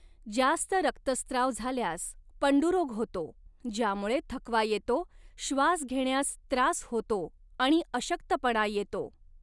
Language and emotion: Marathi, neutral